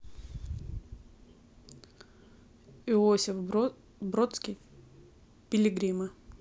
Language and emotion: Russian, neutral